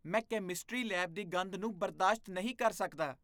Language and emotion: Punjabi, disgusted